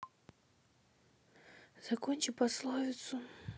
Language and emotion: Russian, sad